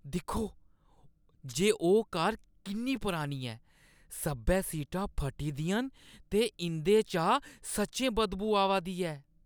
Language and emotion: Dogri, disgusted